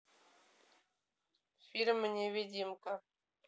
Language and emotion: Russian, neutral